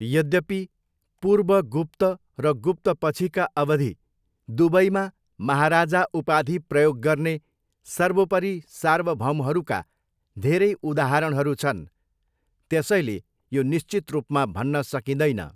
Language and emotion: Nepali, neutral